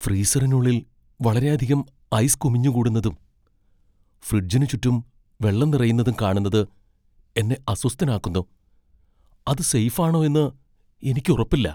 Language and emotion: Malayalam, fearful